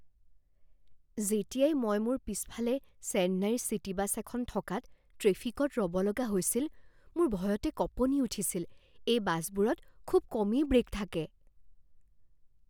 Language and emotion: Assamese, fearful